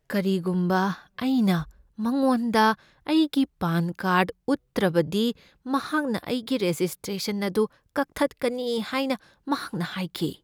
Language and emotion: Manipuri, fearful